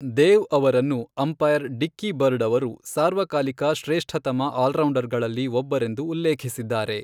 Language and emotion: Kannada, neutral